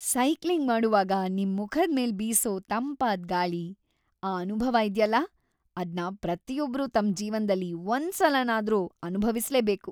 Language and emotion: Kannada, happy